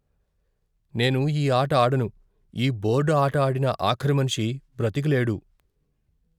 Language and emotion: Telugu, fearful